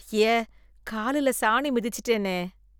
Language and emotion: Tamil, disgusted